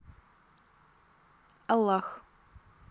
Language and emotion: Russian, neutral